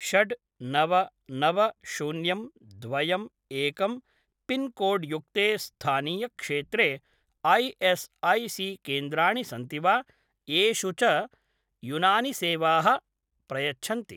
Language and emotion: Sanskrit, neutral